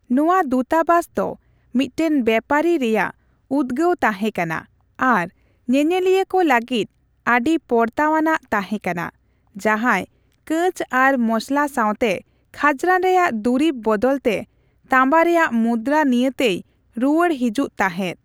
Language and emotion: Santali, neutral